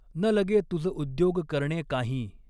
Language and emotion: Marathi, neutral